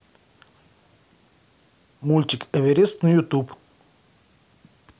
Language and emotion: Russian, neutral